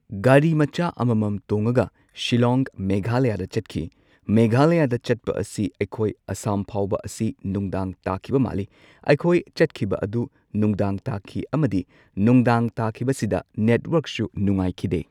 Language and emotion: Manipuri, neutral